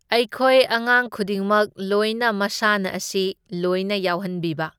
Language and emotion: Manipuri, neutral